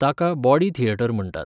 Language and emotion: Goan Konkani, neutral